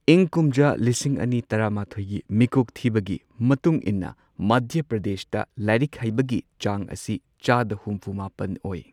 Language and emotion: Manipuri, neutral